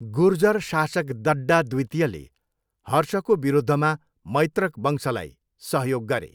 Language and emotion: Nepali, neutral